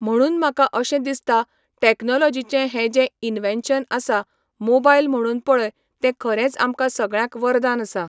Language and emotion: Goan Konkani, neutral